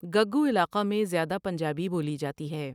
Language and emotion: Urdu, neutral